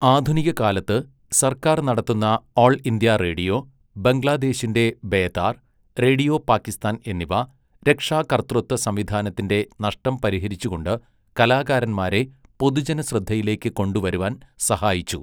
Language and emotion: Malayalam, neutral